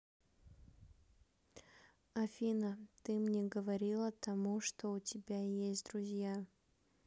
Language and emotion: Russian, neutral